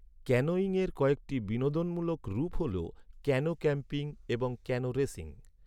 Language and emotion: Bengali, neutral